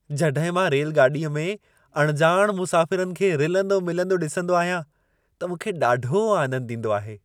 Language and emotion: Sindhi, happy